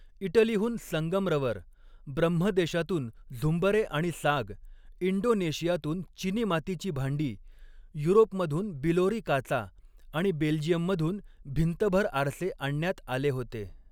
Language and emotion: Marathi, neutral